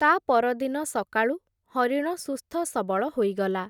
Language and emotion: Odia, neutral